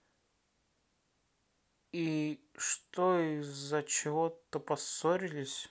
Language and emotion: Russian, sad